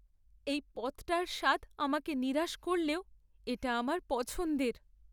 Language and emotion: Bengali, sad